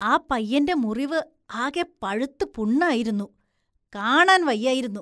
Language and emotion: Malayalam, disgusted